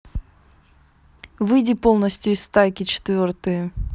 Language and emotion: Russian, neutral